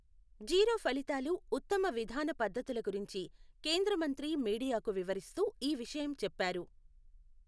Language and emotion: Telugu, neutral